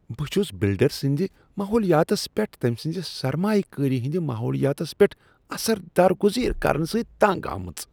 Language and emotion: Kashmiri, disgusted